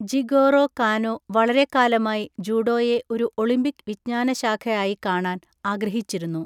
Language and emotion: Malayalam, neutral